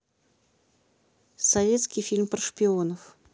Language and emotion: Russian, neutral